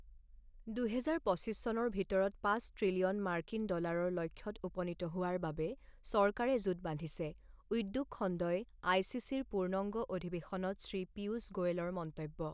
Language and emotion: Assamese, neutral